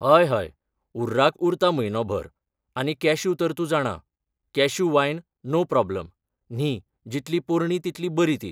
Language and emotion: Goan Konkani, neutral